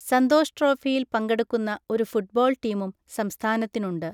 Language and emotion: Malayalam, neutral